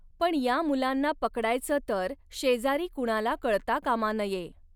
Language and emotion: Marathi, neutral